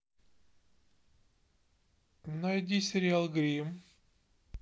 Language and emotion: Russian, neutral